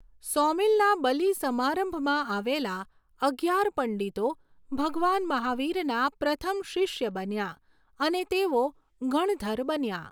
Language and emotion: Gujarati, neutral